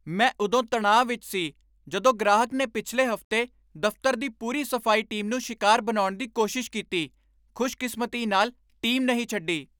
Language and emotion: Punjabi, angry